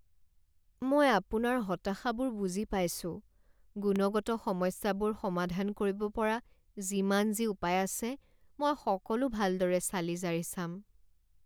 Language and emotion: Assamese, sad